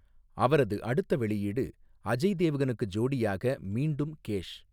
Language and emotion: Tamil, neutral